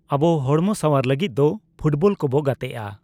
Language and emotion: Santali, neutral